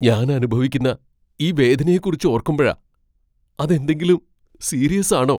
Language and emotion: Malayalam, fearful